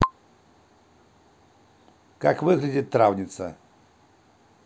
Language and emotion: Russian, neutral